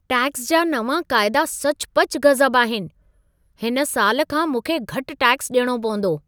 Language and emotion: Sindhi, surprised